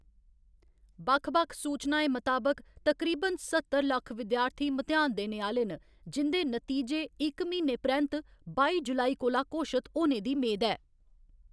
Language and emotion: Dogri, neutral